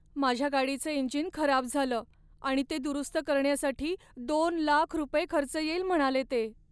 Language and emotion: Marathi, sad